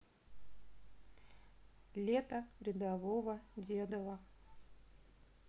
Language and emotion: Russian, neutral